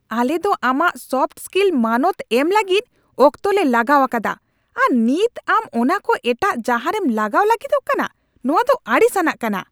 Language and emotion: Santali, angry